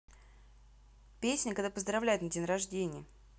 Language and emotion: Russian, neutral